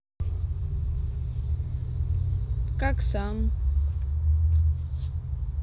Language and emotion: Russian, neutral